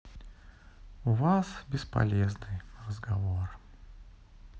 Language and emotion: Russian, sad